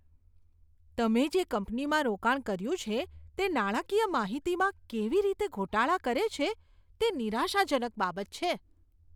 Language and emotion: Gujarati, disgusted